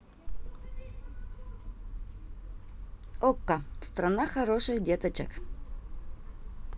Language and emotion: Russian, positive